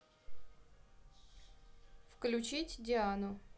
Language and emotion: Russian, neutral